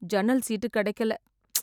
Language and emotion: Tamil, sad